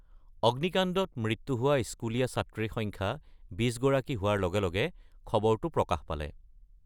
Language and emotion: Assamese, neutral